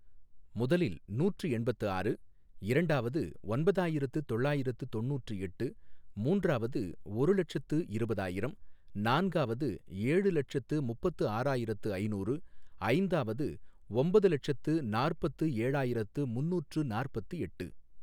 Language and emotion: Tamil, neutral